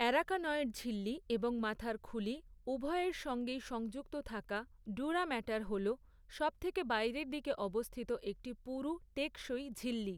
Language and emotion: Bengali, neutral